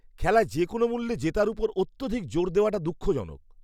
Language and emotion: Bengali, disgusted